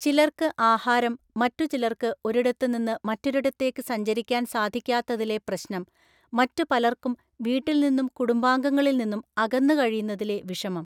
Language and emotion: Malayalam, neutral